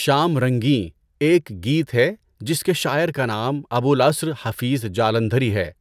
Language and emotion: Urdu, neutral